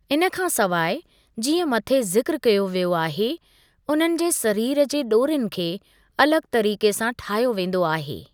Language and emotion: Sindhi, neutral